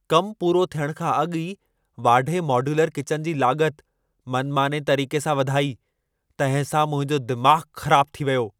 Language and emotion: Sindhi, angry